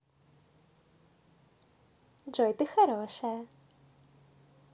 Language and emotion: Russian, positive